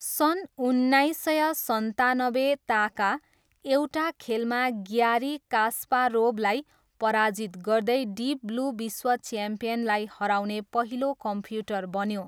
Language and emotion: Nepali, neutral